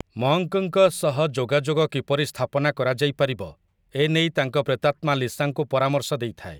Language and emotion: Odia, neutral